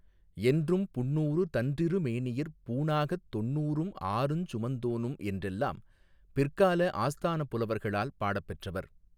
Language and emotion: Tamil, neutral